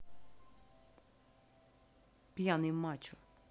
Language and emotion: Russian, neutral